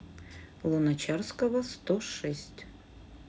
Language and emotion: Russian, neutral